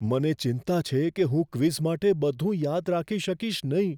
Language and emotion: Gujarati, fearful